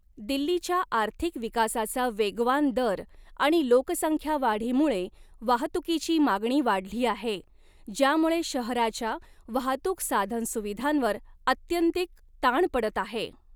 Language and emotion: Marathi, neutral